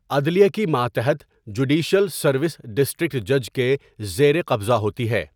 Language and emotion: Urdu, neutral